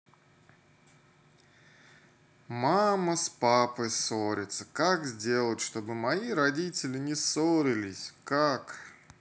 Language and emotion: Russian, sad